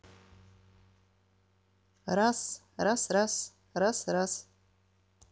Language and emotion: Russian, neutral